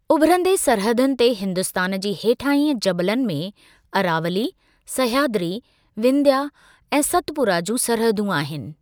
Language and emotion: Sindhi, neutral